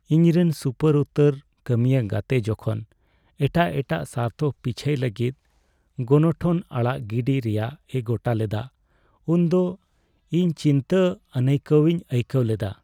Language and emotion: Santali, sad